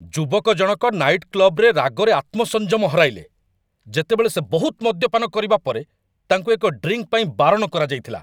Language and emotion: Odia, angry